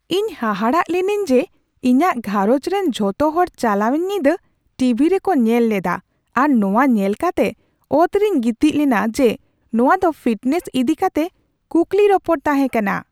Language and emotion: Santali, surprised